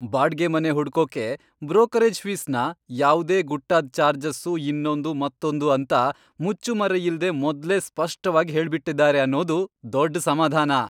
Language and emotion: Kannada, happy